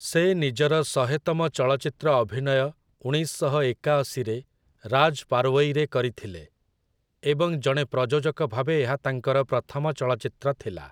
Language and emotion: Odia, neutral